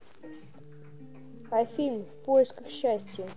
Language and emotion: Russian, neutral